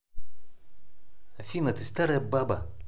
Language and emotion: Russian, angry